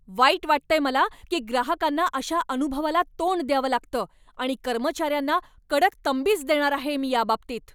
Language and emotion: Marathi, angry